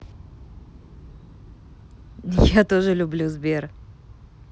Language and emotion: Russian, positive